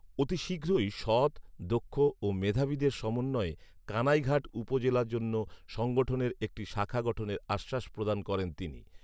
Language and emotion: Bengali, neutral